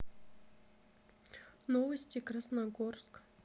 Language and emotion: Russian, neutral